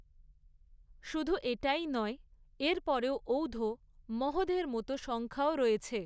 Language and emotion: Bengali, neutral